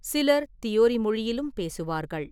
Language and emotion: Tamil, neutral